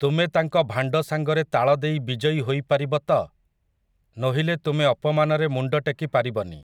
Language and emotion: Odia, neutral